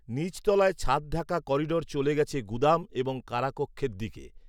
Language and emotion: Bengali, neutral